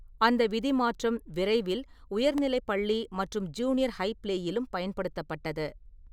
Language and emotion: Tamil, neutral